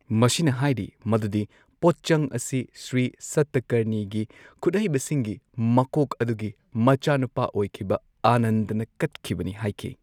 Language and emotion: Manipuri, neutral